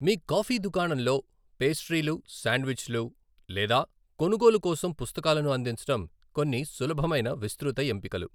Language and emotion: Telugu, neutral